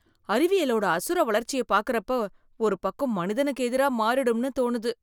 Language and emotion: Tamil, fearful